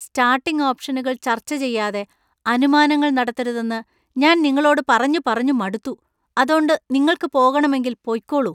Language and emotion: Malayalam, disgusted